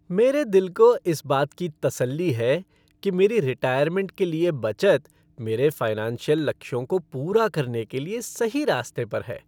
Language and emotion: Hindi, happy